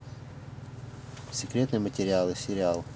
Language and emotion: Russian, neutral